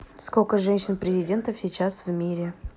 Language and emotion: Russian, neutral